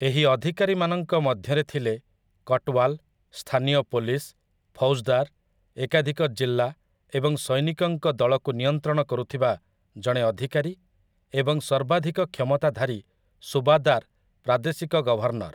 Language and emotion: Odia, neutral